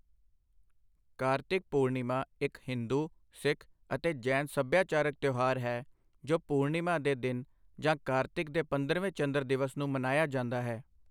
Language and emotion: Punjabi, neutral